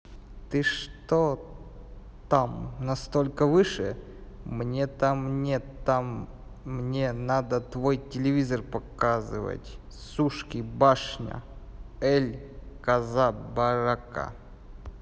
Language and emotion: Russian, neutral